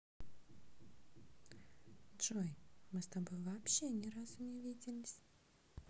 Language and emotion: Russian, neutral